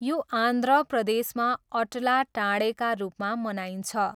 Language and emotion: Nepali, neutral